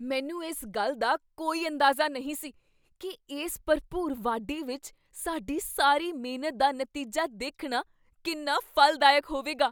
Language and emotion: Punjabi, surprised